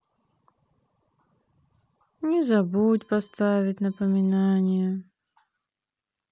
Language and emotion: Russian, sad